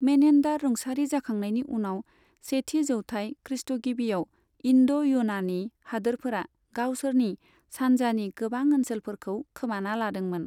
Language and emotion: Bodo, neutral